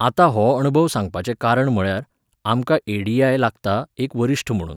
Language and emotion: Goan Konkani, neutral